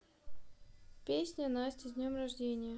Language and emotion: Russian, neutral